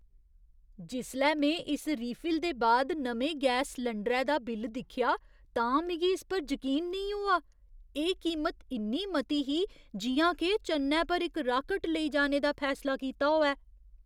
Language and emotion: Dogri, surprised